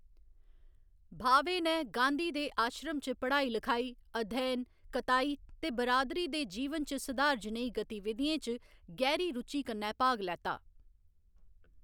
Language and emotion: Dogri, neutral